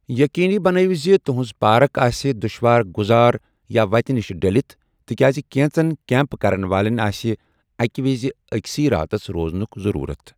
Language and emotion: Kashmiri, neutral